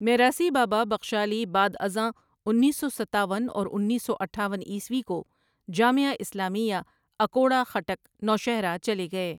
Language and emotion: Urdu, neutral